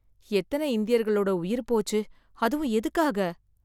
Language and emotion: Tamil, sad